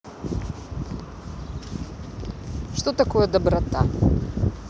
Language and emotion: Russian, neutral